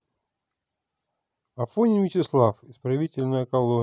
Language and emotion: Russian, neutral